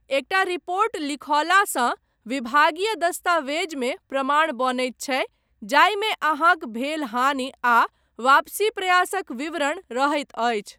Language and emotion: Maithili, neutral